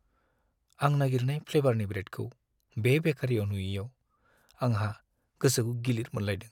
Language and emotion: Bodo, sad